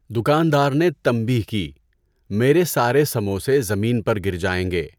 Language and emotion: Urdu, neutral